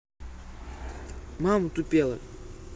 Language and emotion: Russian, neutral